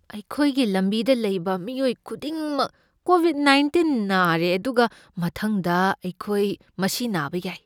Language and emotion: Manipuri, fearful